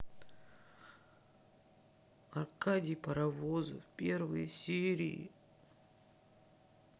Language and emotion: Russian, sad